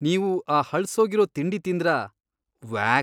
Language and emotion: Kannada, disgusted